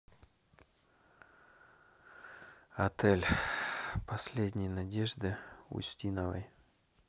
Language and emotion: Russian, sad